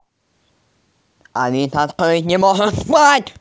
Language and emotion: Russian, angry